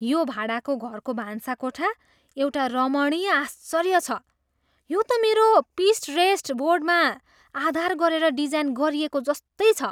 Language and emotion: Nepali, surprised